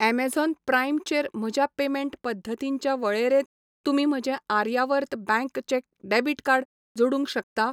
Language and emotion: Goan Konkani, neutral